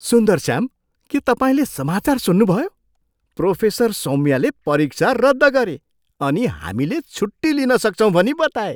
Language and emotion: Nepali, surprised